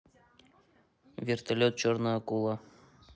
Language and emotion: Russian, neutral